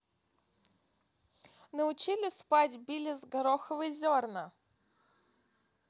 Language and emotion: Russian, neutral